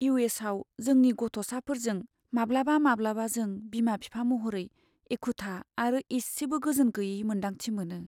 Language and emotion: Bodo, sad